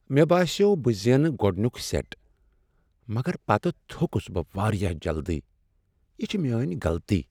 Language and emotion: Kashmiri, sad